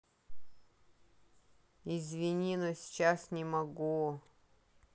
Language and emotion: Russian, neutral